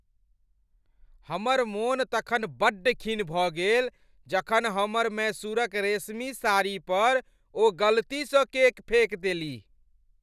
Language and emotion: Maithili, angry